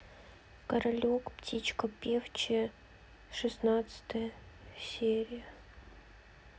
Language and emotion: Russian, sad